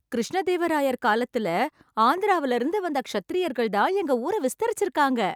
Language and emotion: Tamil, happy